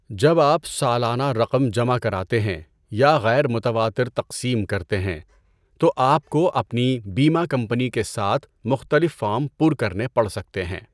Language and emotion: Urdu, neutral